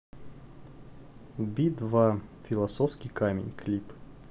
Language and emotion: Russian, neutral